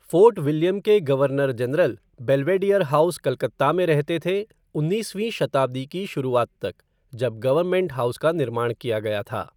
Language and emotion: Hindi, neutral